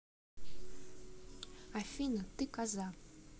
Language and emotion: Russian, neutral